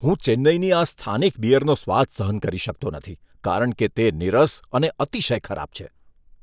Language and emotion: Gujarati, disgusted